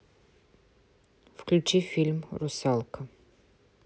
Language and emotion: Russian, neutral